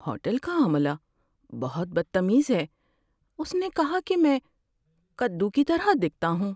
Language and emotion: Urdu, sad